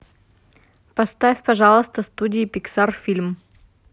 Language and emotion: Russian, neutral